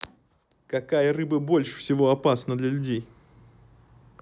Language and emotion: Russian, neutral